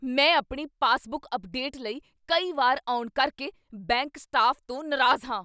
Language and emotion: Punjabi, angry